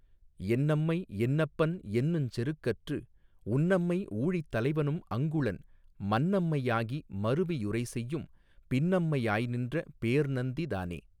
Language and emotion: Tamil, neutral